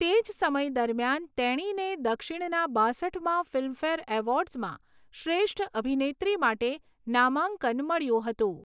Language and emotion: Gujarati, neutral